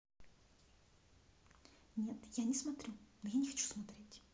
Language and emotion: Russian, neutral